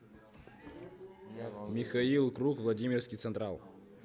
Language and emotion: Russian, neutral